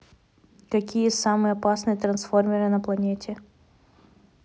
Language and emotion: Russian, neutral